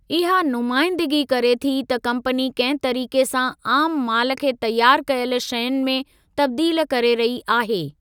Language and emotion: Sindhi, neutral